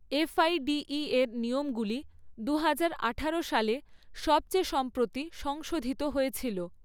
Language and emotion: Bengali, neutral